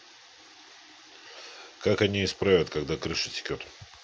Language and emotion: Russian, neutral